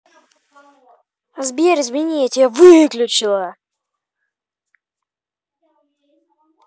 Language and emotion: Russian, neutral